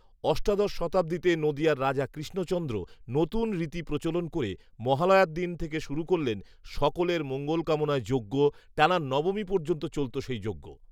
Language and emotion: Bengali, neutral